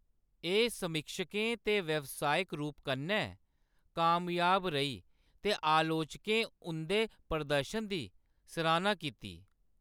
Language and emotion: Dogri, neutral